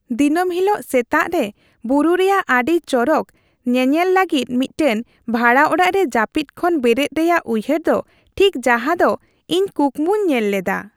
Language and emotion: Santali, happy